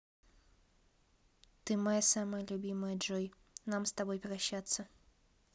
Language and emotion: Russian, neutral